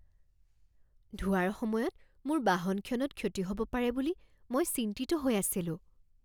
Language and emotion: Assamese, fearful